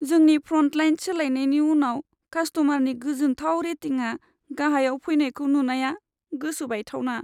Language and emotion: Bodo, sad